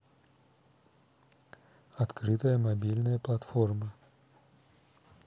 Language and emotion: Russian, neutral